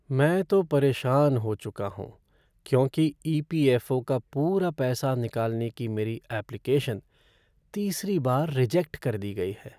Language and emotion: Hindi, sad